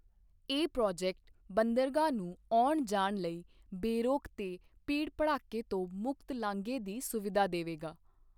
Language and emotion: Punjabi, neutral